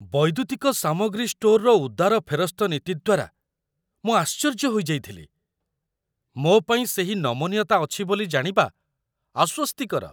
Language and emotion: Odia, surprised